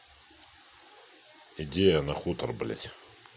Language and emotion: Russian, angry